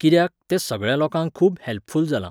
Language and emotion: Goan Konkani, neutral